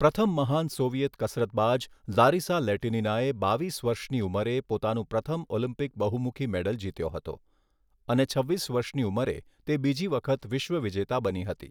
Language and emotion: Gujarati, neutral